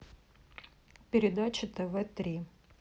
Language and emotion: Russian, neutral